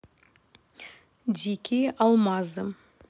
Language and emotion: Russian, neutral